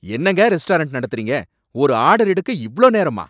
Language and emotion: Tamil, angry